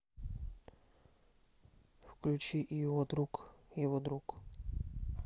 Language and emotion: Russian, neutral